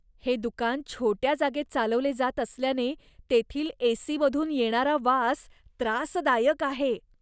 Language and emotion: Marathi, disgusted